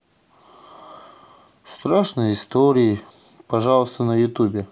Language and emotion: Russian, sad